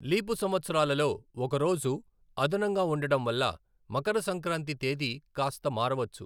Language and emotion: Telugu, neutral